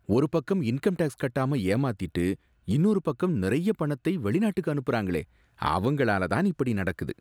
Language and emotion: Tamil, disgusted